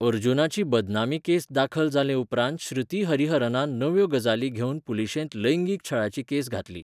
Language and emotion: Goan Konkani, neutral